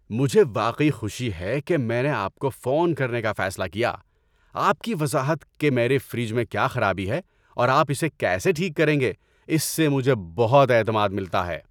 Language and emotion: Urdu, happy